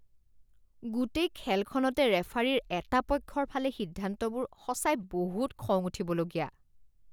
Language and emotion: Assamese, disgusted